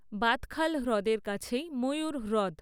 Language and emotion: Bengali, neutral